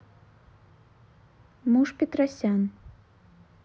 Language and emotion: Russian, neutral